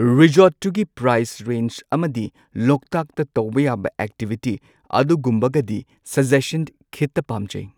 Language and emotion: Manipuri, neutral